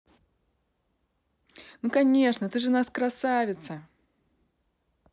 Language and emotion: Russian, positive